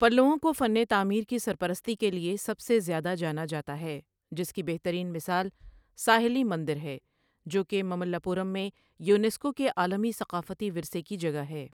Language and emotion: Urdu, neutral